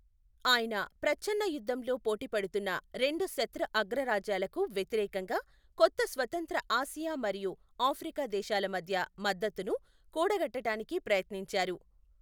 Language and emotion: Telugu, neutral